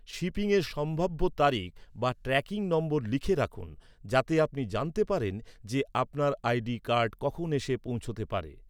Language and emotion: Bengali, neutral